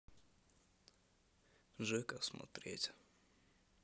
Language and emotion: Russian, neutral